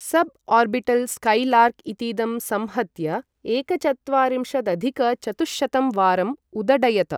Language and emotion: Sanskrit, neutral